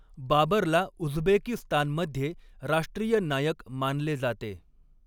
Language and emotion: Marathi, neutral